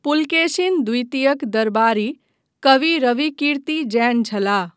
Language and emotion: Maithili, neutral